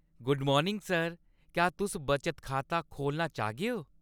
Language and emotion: Dogri, happy